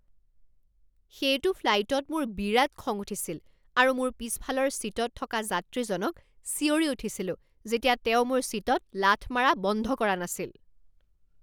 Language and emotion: Assamese, angry